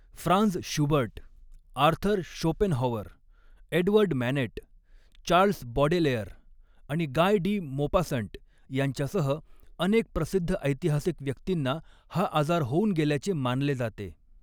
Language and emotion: Marathi, neutral